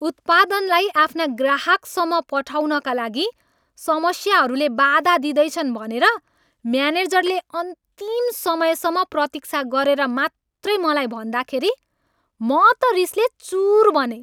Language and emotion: Nepali, angry